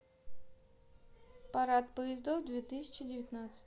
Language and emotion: Russian, neutral